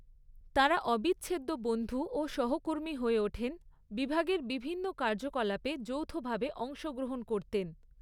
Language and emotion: Bengali, neutral